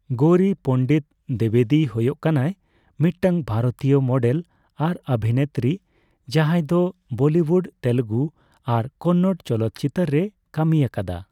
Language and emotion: Santali, neutral